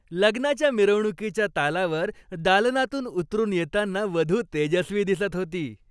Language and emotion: Marathi, happy